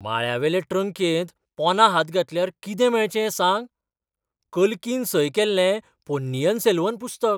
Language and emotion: Goan Konkani, surprised